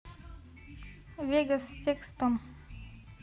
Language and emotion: Russian, neutral